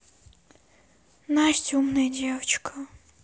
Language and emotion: Russian, sad